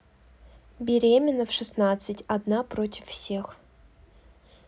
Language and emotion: Russian, neutral